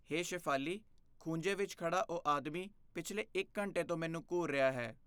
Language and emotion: Punjabi, fearful